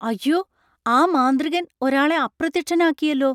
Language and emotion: Malayalam, surprised